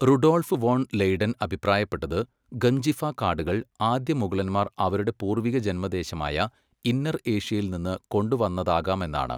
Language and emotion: Malayalam, neutral